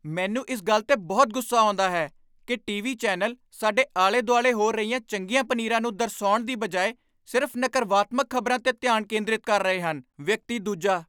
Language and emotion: Punjabi, angry